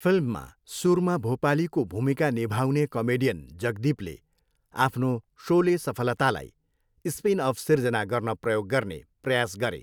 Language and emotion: Nepali, neutral